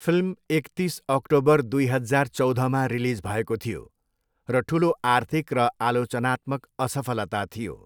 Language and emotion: Nepali, neutral